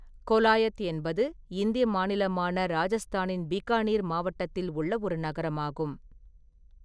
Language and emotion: Tamil, neutral